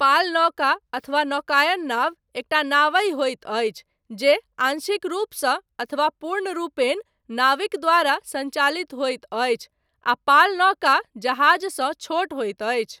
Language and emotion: Maithili, neutral